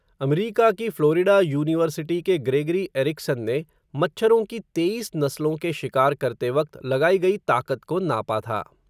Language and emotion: Hindi, neutral